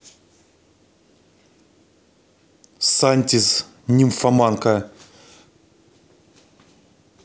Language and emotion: Russian, angry